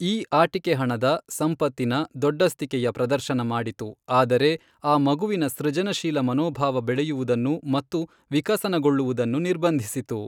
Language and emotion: Kannada, neutral